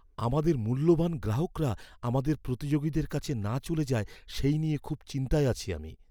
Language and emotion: Bengali, fearful